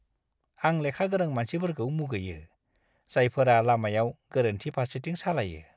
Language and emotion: Bodo, disgusted